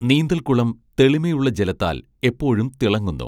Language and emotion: Malayalam, neutral